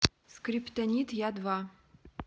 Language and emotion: Russian, neutral